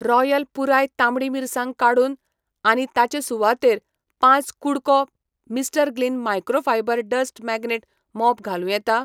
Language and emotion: Goan Konkani, neutral